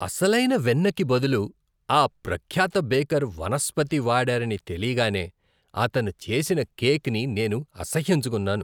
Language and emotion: Telugu, disgusted